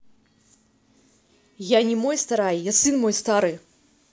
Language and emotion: Russian, angry